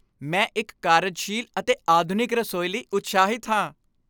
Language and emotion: Punjabi, happy